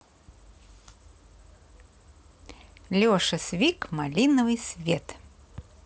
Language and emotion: Russian, positive